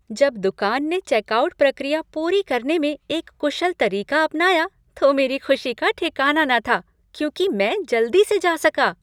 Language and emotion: Hindi, happy